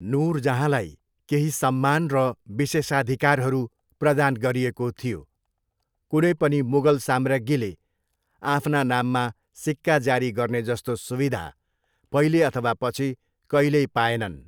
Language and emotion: Nepali, neutral